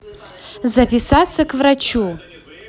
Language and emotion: Russian, positive